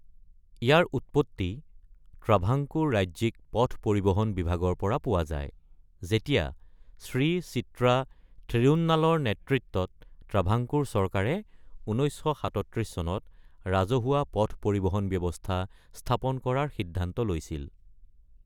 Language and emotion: Assamese, neutral